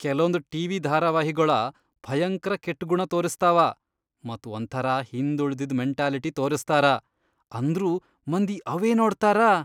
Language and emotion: Kannada, disgusted